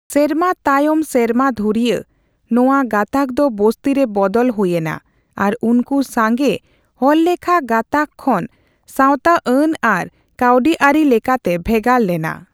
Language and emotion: Santali, neutral